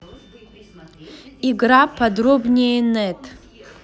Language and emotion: Russian, neutral